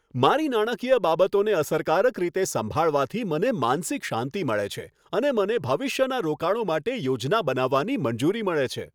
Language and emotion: Gujarati, happy